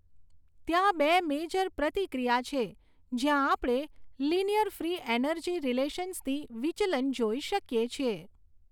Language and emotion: Gujarati, neutral